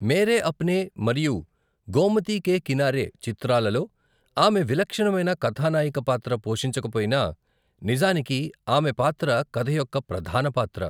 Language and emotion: Telugu, neutral